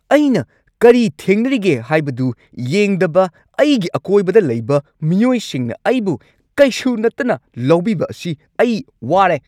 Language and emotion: Manipuri, angry